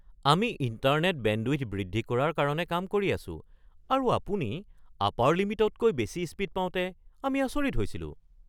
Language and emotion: Assamese, surprised